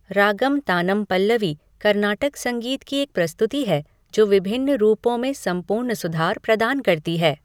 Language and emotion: Hindi, neutral